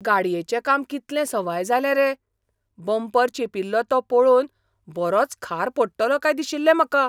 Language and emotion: Goan Konkani, surprised